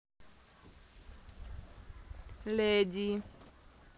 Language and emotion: Russian, neutral